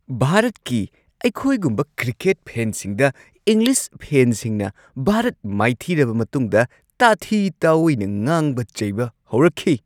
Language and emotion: Manipuri, angry